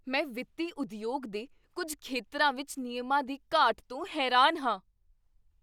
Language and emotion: Punjabi, surprised